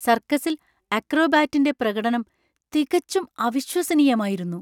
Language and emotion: Malayalam, surprised